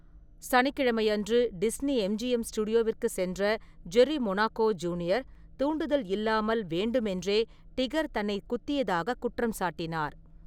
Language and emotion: Tamil, neutral